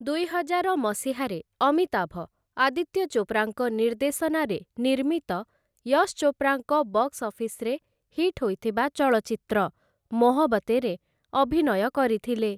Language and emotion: Odia, neutral